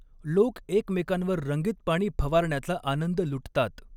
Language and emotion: Marathi, neutral